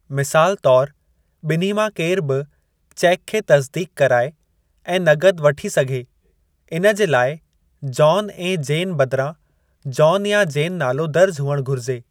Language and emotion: Sindhi, neutral